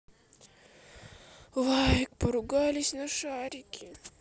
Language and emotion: Russian, sad